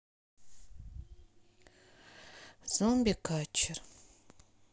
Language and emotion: Russian, sad